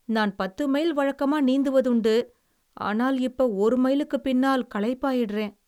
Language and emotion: Tamil, sad